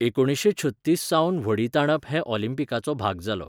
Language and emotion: Goan Konkani, neutral